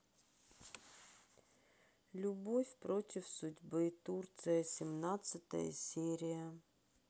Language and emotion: Russian, sad